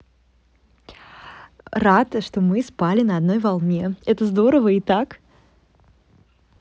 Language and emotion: Russian, positive